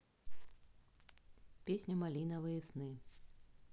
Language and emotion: Russian, neutral